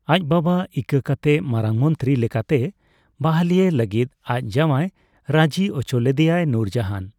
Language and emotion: Santali, neutral